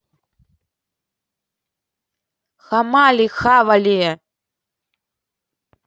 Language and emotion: Russian, angry